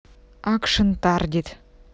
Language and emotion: Russian, neutral